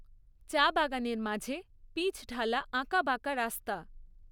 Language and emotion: Bengali, neutral